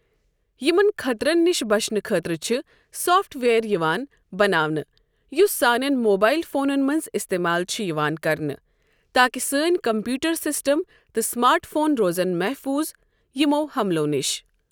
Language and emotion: Kashmiri, neutral